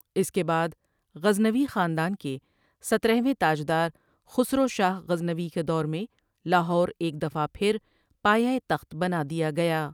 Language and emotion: Urdu, neutral